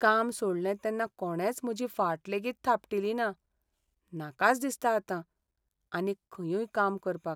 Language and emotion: Goan Konkani, sad